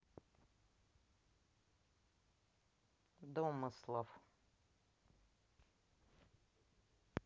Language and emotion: Russian, neutral